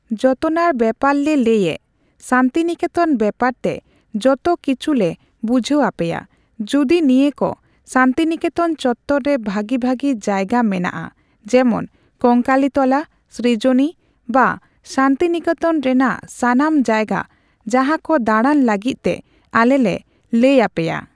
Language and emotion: Santali, neutral